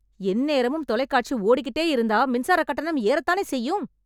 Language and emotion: Tamil, angry